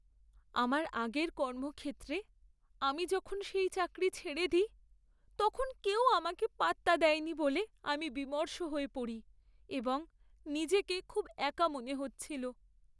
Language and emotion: Bengali, sad